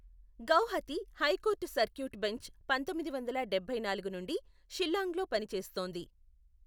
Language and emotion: Telugu, neutral